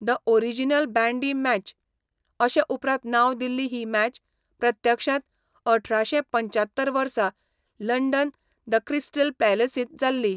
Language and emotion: Goan Konkani, neutral